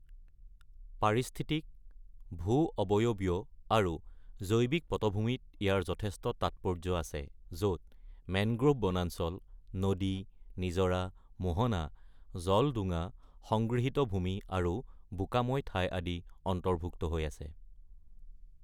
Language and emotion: Assamese, neutral